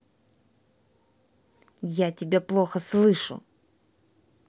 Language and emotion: Russian, angry